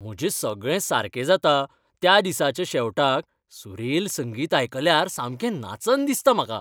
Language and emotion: Goan Konkani, happy